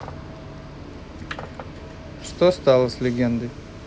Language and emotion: Russian, neutral